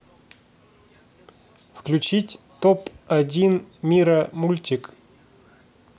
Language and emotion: Russian, neutral